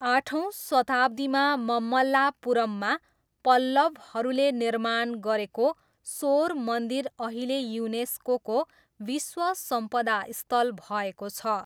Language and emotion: Nepali, neutral